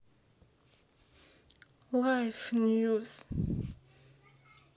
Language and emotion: Russian, sad